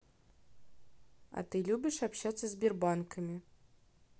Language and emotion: Russian, neutral